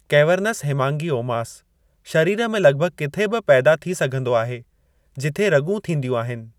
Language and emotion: Sindhi, neutral